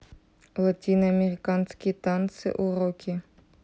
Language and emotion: Russian, neutral